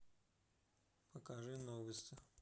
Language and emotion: Russian, neutral